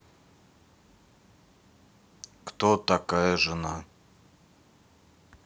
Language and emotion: Russian, neutral